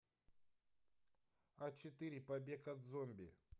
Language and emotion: Russian, neutral